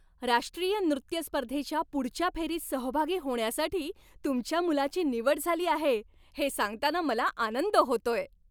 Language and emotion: Marathi, happy